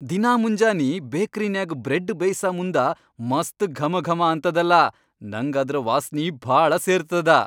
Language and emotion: Kannada, happy